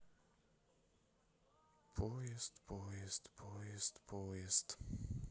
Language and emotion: Russian, sad